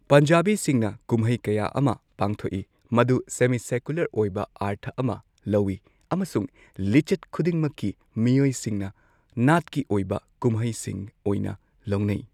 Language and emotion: Manipuri, neutral